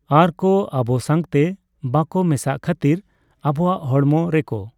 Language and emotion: Santali, neutral